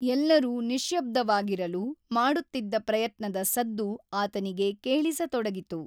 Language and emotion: Kannada, neutral